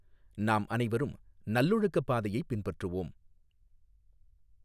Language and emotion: Tamil, neutral